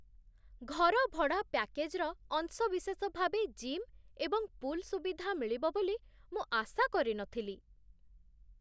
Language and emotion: Odia, surprised